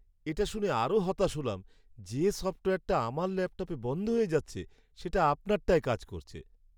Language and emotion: Bengali, sad